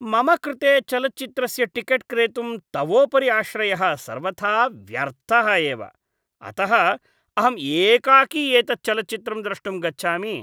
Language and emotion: Sanskrit, disgusted